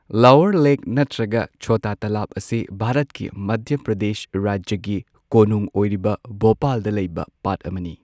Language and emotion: Manipuri, neutral